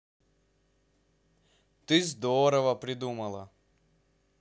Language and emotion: Russian, positive